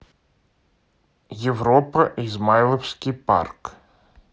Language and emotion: Russian, neutral